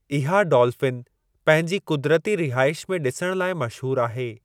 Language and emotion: Sindhi, neutral